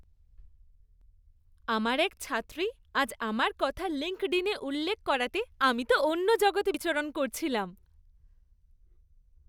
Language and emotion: Bengali, happy